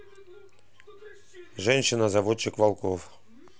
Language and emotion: Russian, neutral